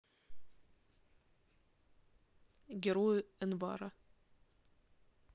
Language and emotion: Russian, neutral